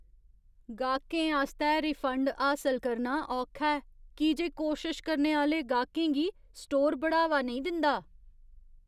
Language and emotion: Dogri, disgusted